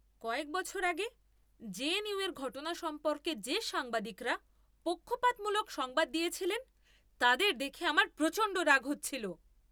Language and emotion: Bengali, angry